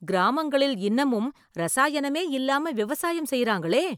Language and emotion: Tamil, surprised